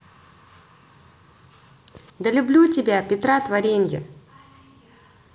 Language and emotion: Russian, positive